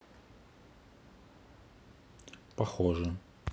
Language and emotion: Russian, neutral